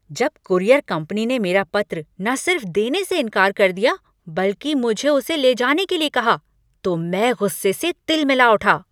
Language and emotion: Hindi, angry